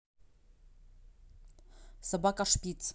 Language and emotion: Russian, neutral